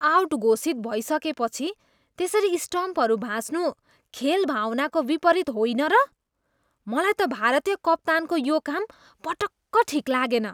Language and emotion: Nepali, disgusted